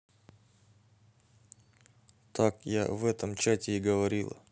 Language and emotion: Russian, neutral